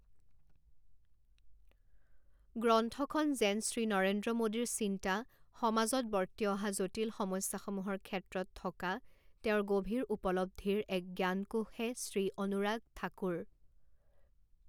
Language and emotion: Assamese, neutral